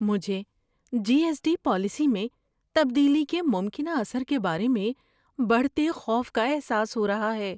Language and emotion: Urdu, fearful